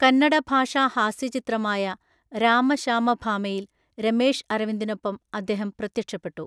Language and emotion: Malayalam, neutral